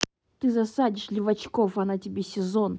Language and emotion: Russian, angry